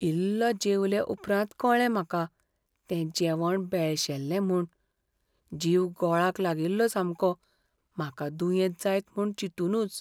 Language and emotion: Goan Konkani, fearful